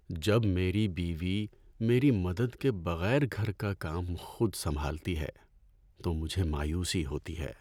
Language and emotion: Urdu, sad